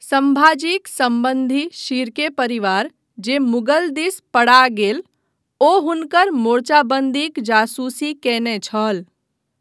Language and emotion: Maithili, neutral